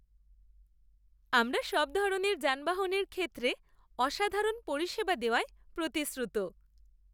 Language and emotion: Bengali, happy